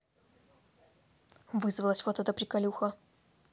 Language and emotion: Russian, angry